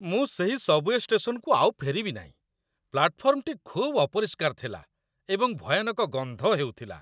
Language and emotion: Odia, disgusted